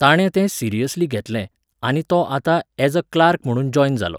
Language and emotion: Goan Konkani, neutral